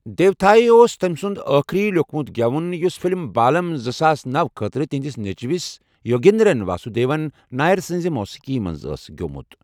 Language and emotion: Kashmiri, neutral